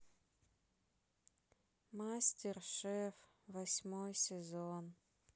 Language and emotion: Russian, sad